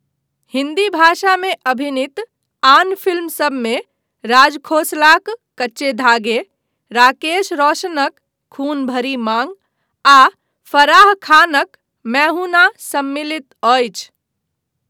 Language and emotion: Maithili, neutral